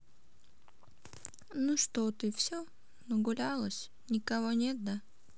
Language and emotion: Russian, sad